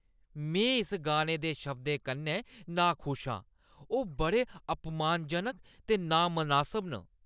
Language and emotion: Dogri, disgusted